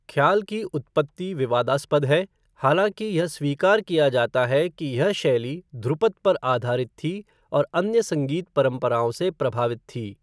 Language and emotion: Hindi, neutral